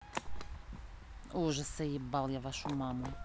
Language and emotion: Russian, angry